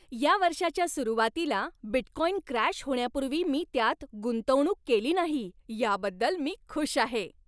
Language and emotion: Marathi, happy